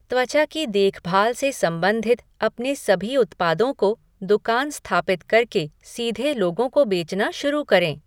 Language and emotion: Hindi, neutral